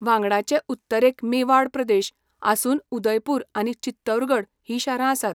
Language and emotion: Goan Konkani, neutral